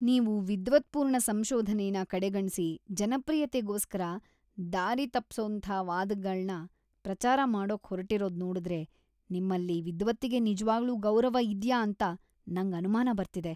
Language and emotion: Kannada, disgusted